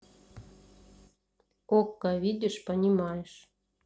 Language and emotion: Russian, neutral